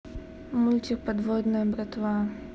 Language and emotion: Russian, neutral